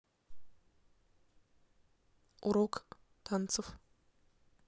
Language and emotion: Russian, neutral